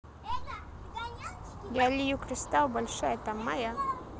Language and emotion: Russian, neutral